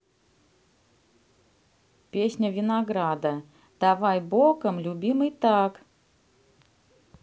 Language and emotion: Russian, neutral